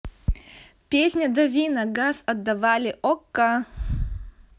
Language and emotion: Russian, positive